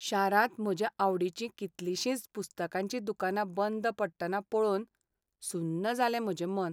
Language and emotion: Goan Konkani, sad